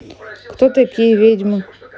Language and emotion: Russian, neutral